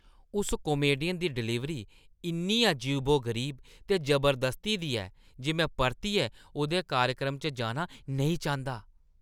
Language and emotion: Dogri, disgusted